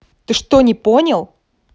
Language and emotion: Russian, angry